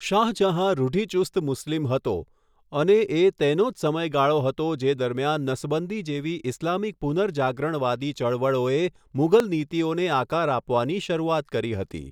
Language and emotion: Gujarati, neutral